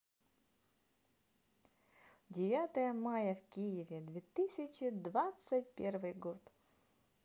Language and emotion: Russian, positive